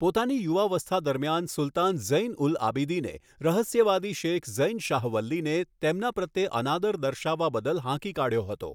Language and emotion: Gujarati, neutral